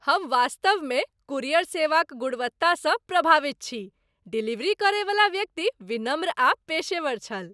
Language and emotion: Maithili, happy